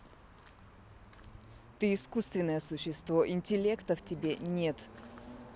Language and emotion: Russian, angry